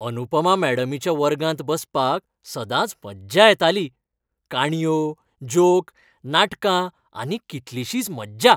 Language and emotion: Goan Konkani, happy